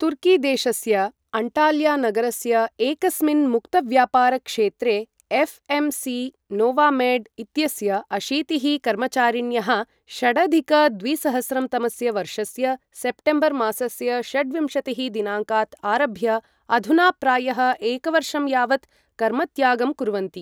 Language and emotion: Sanskrit, neutral